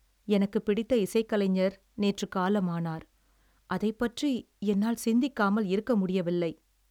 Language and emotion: Tamil, sad